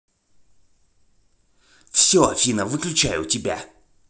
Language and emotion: Russian, angry